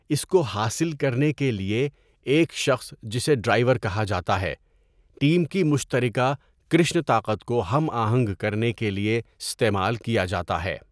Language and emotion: Urdu, neutral